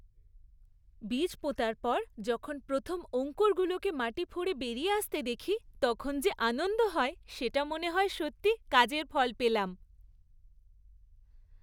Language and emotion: Bengali, happy